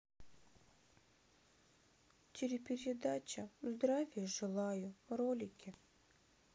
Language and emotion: Russian, sad